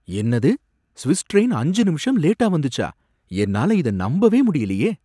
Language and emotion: Tamil, surprised